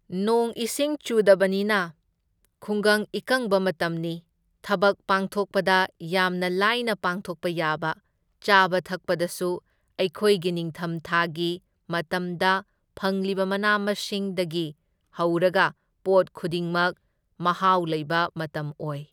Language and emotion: Manipuri, neutral